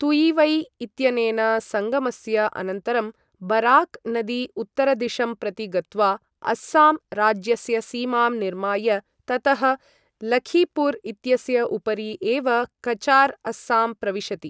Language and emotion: Sanskrit, neutral